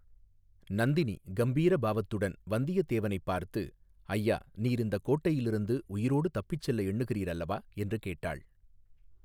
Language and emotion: Tamil, neutral